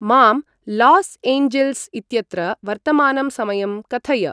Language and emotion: Sanskrit, neutral